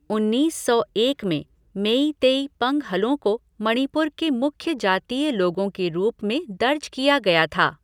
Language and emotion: Hindi, neutral